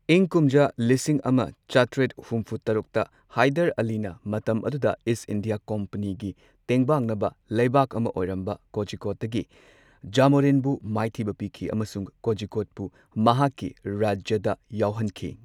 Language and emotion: Manipuri, neutral